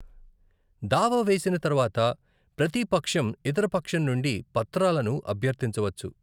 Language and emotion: Telugu, neutral